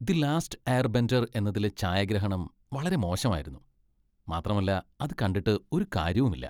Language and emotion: Malayalam, disgusted